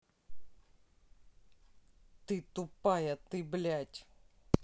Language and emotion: Russian, angry